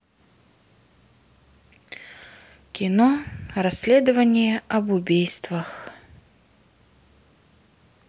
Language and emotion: Russian, sad